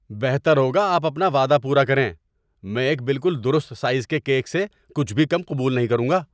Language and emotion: Urdu, angry